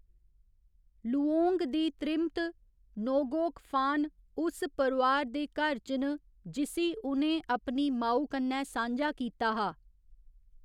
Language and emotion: Dogri, neutral